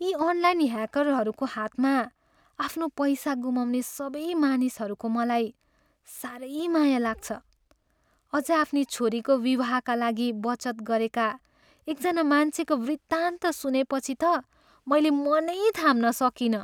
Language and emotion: Nepali, sad